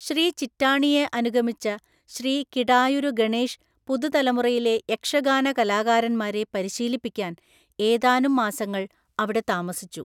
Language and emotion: Malayalam, neutral